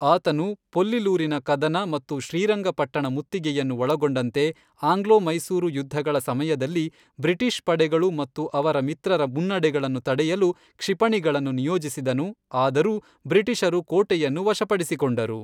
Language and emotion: Kannada, neutral